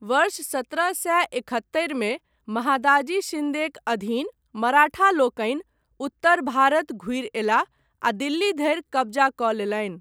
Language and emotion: Maithili, neutral